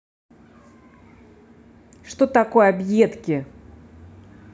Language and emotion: Russian, angry